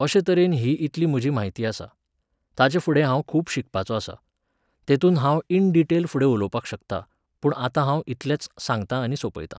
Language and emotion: Goan Konkani, neutral